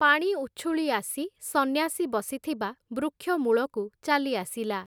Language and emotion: Odia, neutral